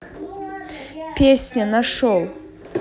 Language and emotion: Russian, neutral